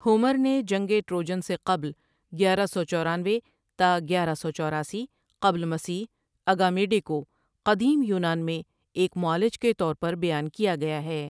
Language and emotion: Urdu, neutral